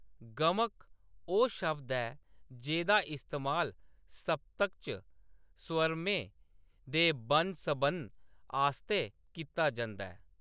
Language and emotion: Dogri, neutral